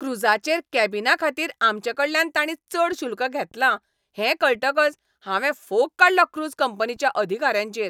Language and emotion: Goan Konkani, angry